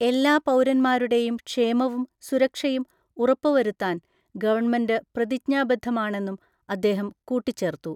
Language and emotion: Malayalam, neutral